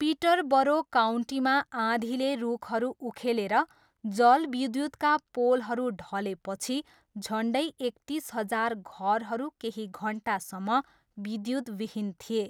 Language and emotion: Nepali, neutral